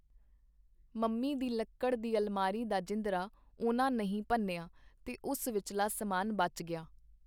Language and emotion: Punjabi, neutral